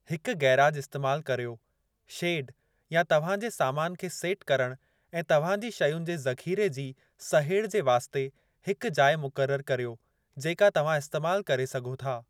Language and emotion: Sindhi, neutral